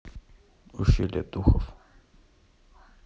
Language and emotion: Russian, neutral